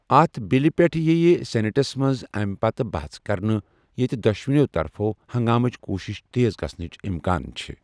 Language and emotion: Kashmiri, neutral